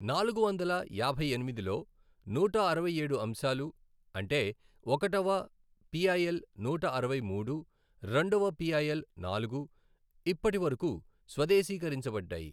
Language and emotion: Telugu, neutral